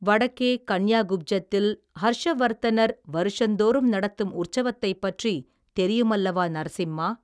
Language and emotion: Tamil, neutral